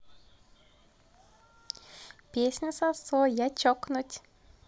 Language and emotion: Russian, positive